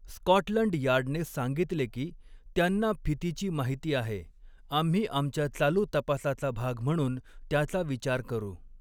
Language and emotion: Marathi, neutral